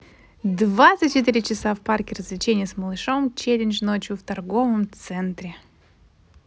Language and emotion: Russian, positive